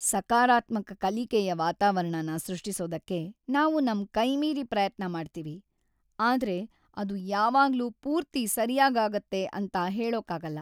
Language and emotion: Kannada, sad